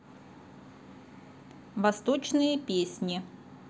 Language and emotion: Russian, neutral